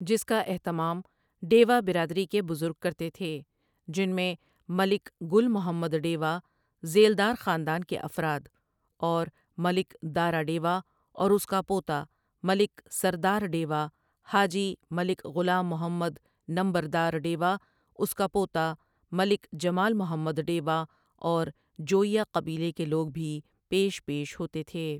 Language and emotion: Urdu, neutral